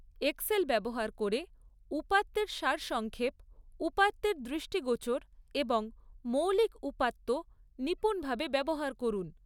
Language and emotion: Bengali, neutral